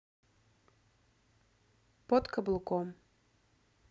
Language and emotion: Russian, neutral